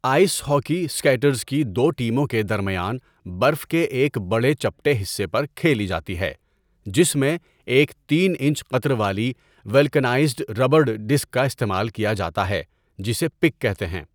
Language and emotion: Urdu, neutral